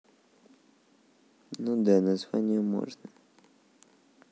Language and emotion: Russian, neutral